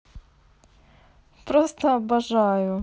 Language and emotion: Russian, positive